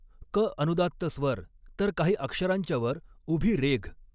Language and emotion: Marathi, neutral